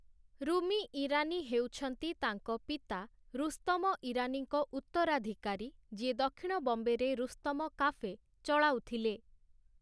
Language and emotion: Odia, neutral